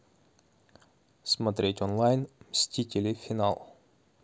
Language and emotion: Russian, neutral